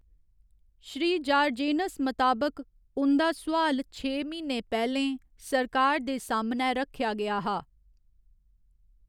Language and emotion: Dogri, neutral